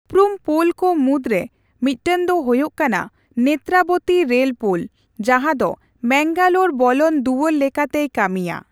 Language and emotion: Santali, neutral